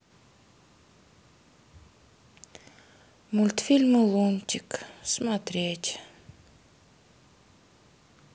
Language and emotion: Russian, sad